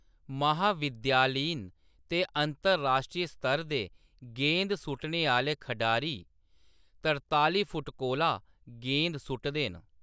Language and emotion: Dogri, neutral